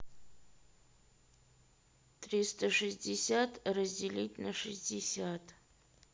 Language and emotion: Russian, neutral